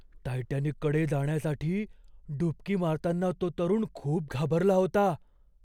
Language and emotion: Marathi, fearful